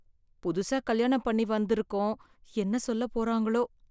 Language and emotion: Tamil, fearful